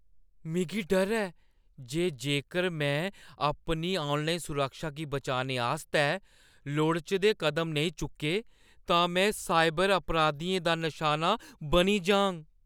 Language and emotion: Dogri, fearful